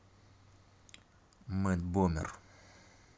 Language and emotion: Russian, neutral